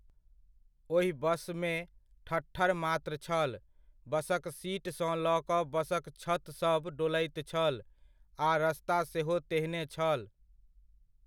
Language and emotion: Maithili, neutral